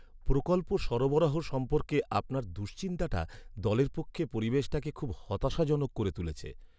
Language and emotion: Bengali, sad